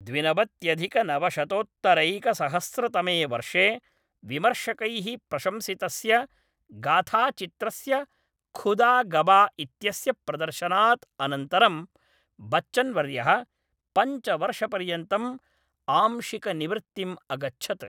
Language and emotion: Sanskrit, neutral